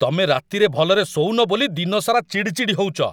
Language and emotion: Odia, angry